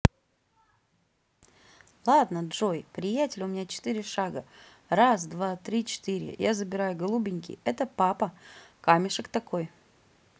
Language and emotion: Russian, positive